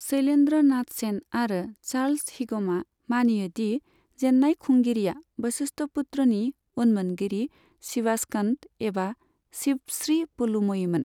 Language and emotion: Bodo, neutral